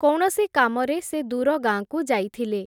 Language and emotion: Odia, neutral